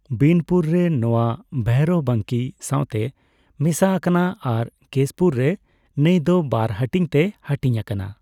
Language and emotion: Santali, neutral